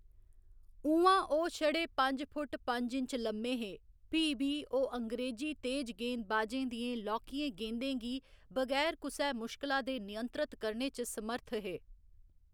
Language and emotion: Dogri, neutral